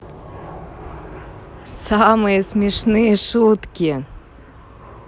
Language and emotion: Russian, positive